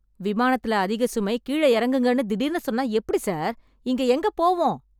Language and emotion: Tamil, angry